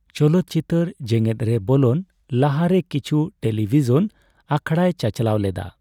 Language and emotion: Santali, neutral